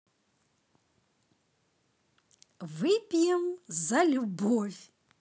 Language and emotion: Russian, positive